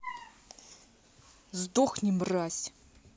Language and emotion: Russian, angry